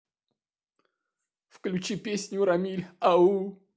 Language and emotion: Russian, sad